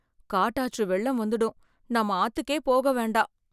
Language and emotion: Tamil, fearful